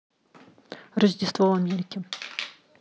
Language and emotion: Russian, neutral